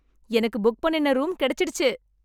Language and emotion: Tamil, happy